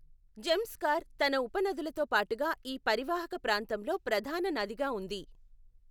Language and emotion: Telugu, neutral